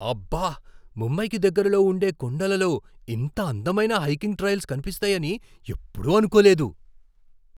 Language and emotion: Telugu, surprised